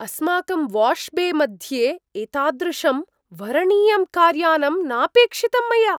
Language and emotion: Sanskrit, surprised